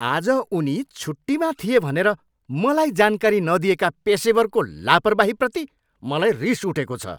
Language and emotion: Nepali, angry